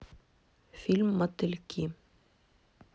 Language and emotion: Russian, neutral